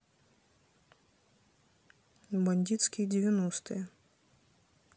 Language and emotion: Russian, neutral